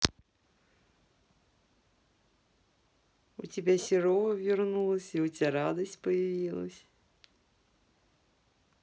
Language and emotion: Russian, positive